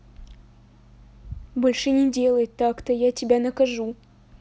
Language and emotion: Russian, neutral